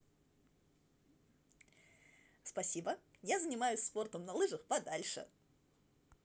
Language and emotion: Russian, positive